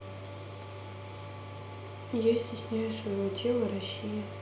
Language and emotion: Russian, sad